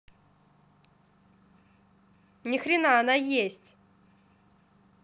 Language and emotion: Russian, angry